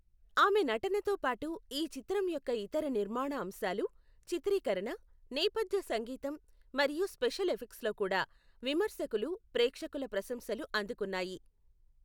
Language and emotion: Telugu, neutral